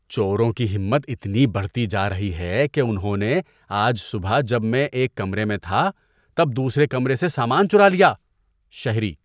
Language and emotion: Urdu, disgusted